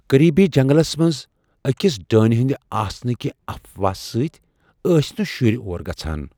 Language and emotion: Kashmiri, fearful